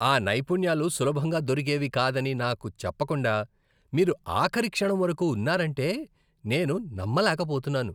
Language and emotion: Telugu, disgusted